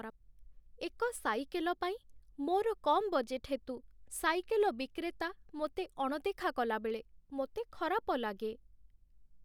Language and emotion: Odia, sad